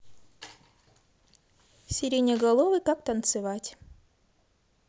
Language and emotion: Russian, positive